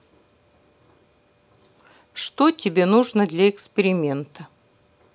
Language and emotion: Russian, neutral